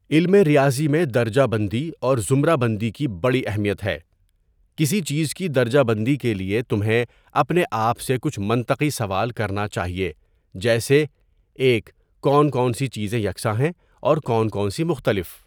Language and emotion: Urdu, neutral